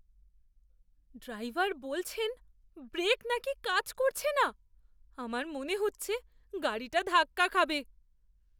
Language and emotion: Bengali, fearful